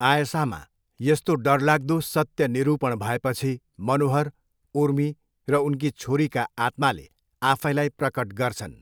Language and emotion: Nepali, neutral